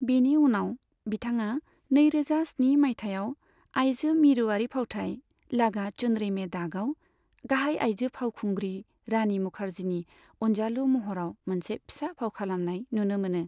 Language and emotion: Bodo, neutral